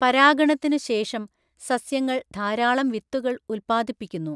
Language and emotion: Malayalam, neutral